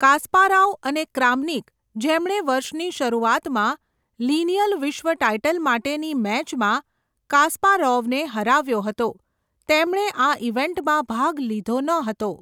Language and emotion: Gujarati, neutral